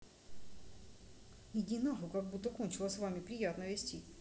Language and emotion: Russian, angry